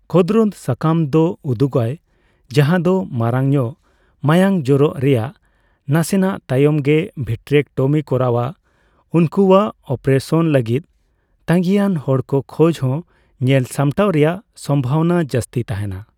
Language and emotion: Santali, neutral